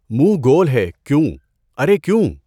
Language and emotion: Urdu, neutral